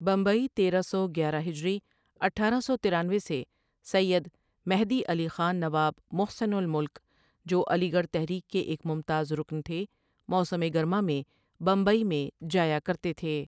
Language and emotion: Urdu, neutral